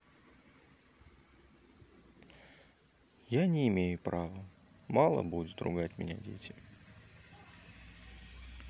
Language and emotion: Russian, sad